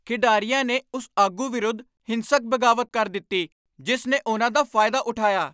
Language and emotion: Punjabi, angry